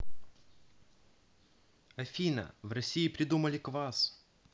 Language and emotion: Russian, neutral